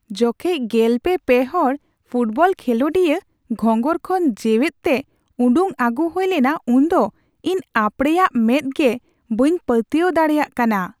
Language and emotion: Santali, surprised